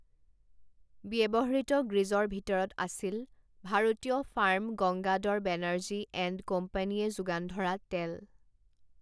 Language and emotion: Assamese, neutral